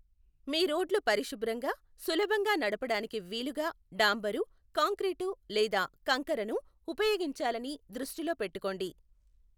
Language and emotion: Telugu, neutral